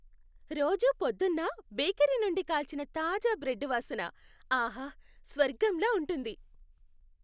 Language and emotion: Telugu, happy